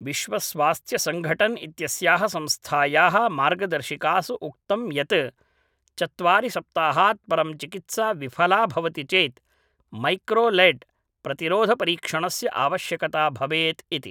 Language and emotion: Sanskrit, neutral